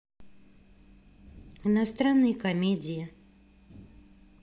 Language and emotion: Russian, neutral